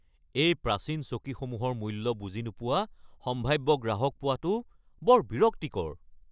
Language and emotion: Assamese, angry